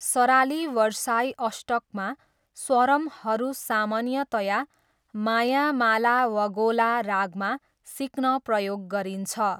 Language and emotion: Nepali, neutral